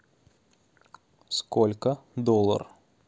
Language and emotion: Russian, neutral